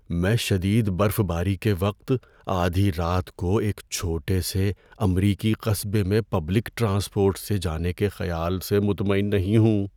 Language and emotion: Urdu, fearful